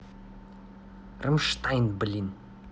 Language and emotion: Russian, angry